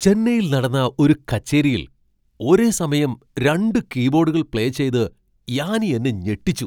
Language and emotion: Malayalam, surprised